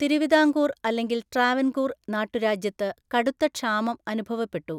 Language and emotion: Malayalam, neutral